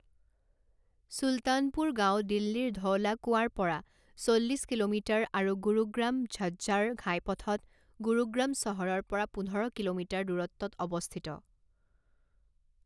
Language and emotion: Assamese, neutral